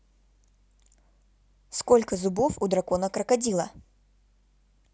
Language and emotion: Russian, neutral